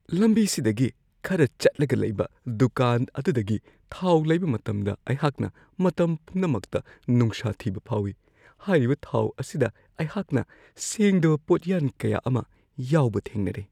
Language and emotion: Manipuri, fearful